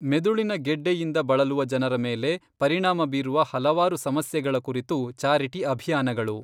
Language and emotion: Kannada, neutral